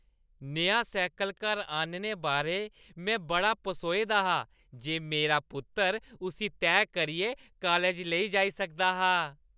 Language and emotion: Dogri, happy